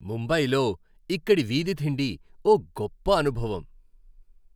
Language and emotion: Telugu, happy